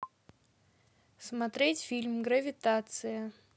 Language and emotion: Russian, neutral